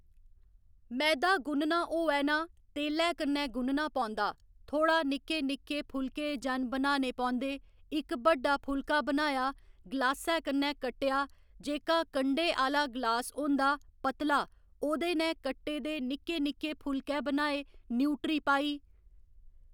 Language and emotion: Dogri, neutral